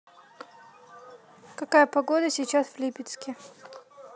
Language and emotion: Russian, neutral